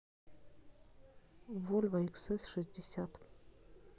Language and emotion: Russian, neutral